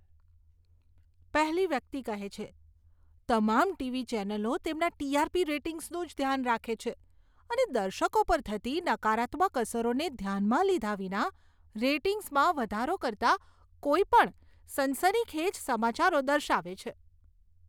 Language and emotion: Gujarati, disgusted